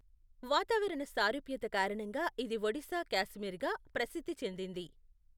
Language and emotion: Telugu, neutral